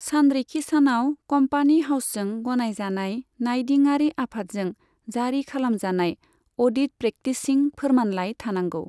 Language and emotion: Bodo, neutral